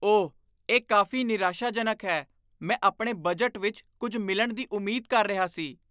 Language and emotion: Punjabi, disgusted